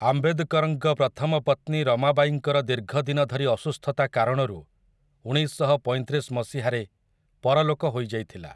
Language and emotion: Odia, neutral